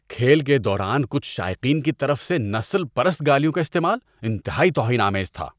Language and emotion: Urdu, disgusted